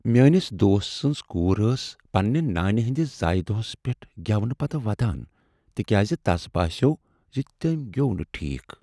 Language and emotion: Kashmiri, sad